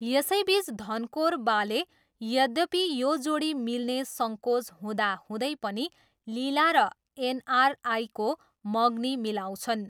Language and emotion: Nepali, neutral